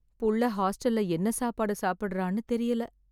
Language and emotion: Tamil, sad